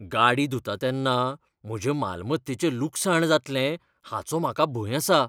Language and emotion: Goan Konkani, fearful